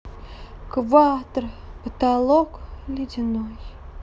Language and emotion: Russian, sad